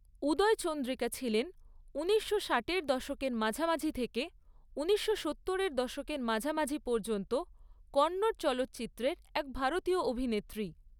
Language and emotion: Bengali, neutral